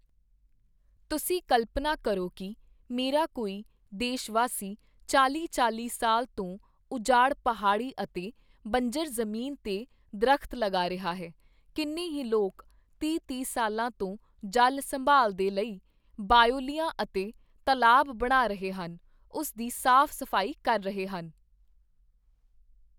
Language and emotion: Punjabi, neutral